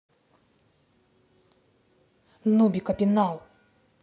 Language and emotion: Russian, angry